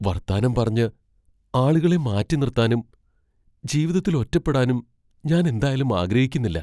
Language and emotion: Malayalam, fearful